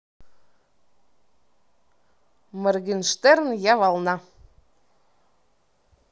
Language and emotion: Russian, neutral